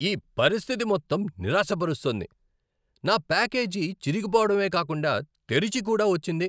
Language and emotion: Telugu, angry